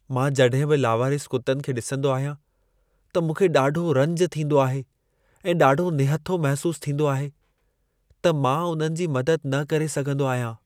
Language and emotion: Sindhi, sad